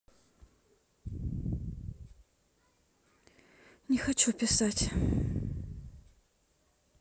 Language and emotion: Russian, sad